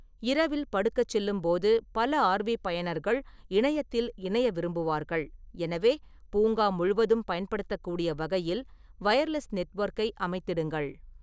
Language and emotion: Tamil, neutral